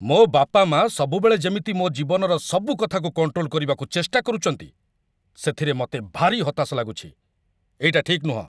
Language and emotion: Odia, angry